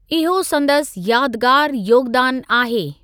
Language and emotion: Sindhi, neutral